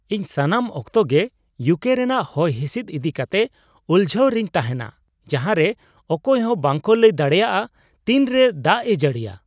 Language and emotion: Santali, surprised